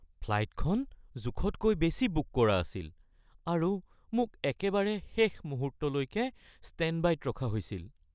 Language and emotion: Assamese, fearful